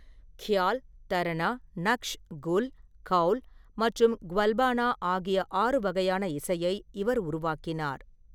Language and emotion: Tamil, neutral